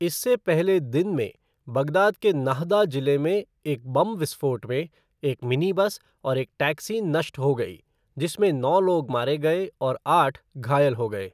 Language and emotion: Hindi, neutral